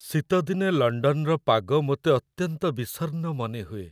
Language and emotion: Odia, sad